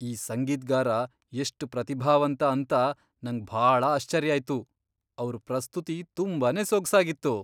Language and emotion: Kannada, surprised